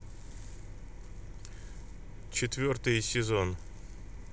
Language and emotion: Russian, neutral